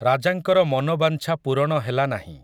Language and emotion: Odia, neutral